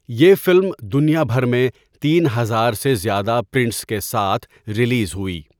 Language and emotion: Urdu, neutral